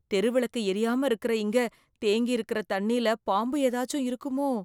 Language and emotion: Tamil, fearful